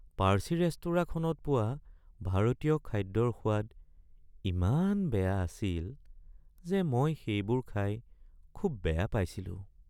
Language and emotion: Assamese, sad